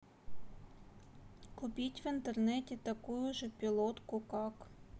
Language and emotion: Russian, neutral